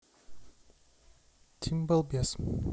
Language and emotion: Russian, neutral